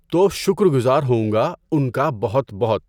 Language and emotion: Urdu, neutral